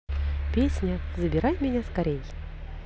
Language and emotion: Russian, positive